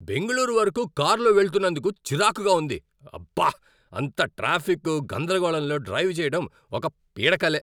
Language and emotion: Telugu, angry